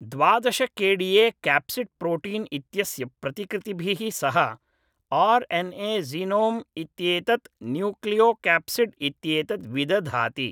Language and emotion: Sanskrit, neutral